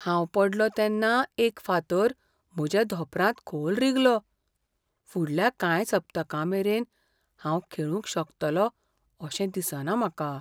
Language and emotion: Goan Konkani, fearful